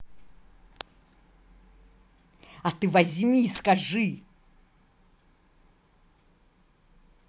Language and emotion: Russian, angry